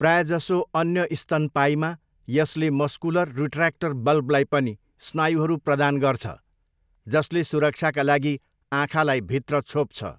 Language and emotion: Nepali, neutral